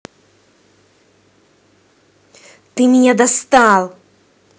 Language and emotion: Russian, angry